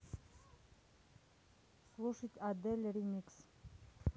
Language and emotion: Russian, neutral